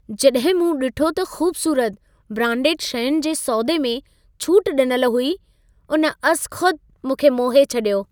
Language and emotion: Sindhi, happy